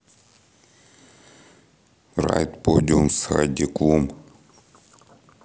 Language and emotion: Russian, neutral